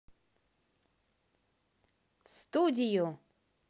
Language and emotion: Russian, positive